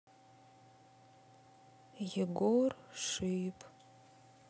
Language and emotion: Russian, sad